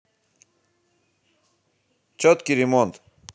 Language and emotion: Russian, positive